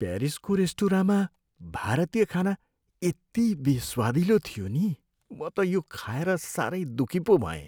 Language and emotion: Nepali, sad